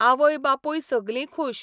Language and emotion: Goan Konkani, neutral